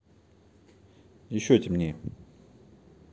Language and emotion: Russian, neutral